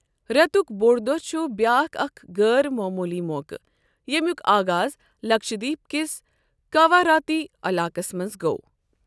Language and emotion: Kashmiri, neutral